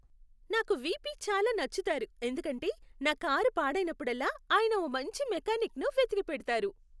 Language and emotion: Telugu, happy